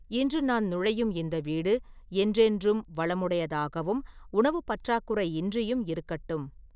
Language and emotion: Tamil, neutral